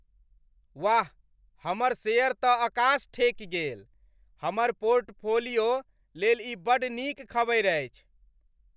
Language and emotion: Maithili, happy